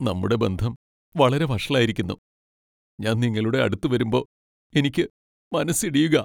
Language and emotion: Malayalam, sad